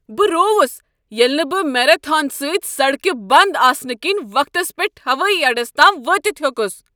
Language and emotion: Kashmiri, angry